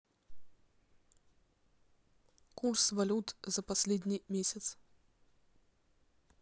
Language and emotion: Russian, neutral